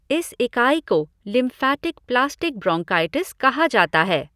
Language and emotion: Hindi, neutral